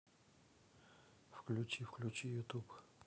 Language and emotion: Russian, neutral